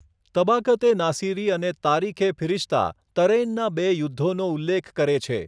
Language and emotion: Gujarati, neutral